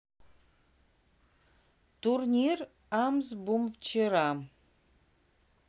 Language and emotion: Russian, neutral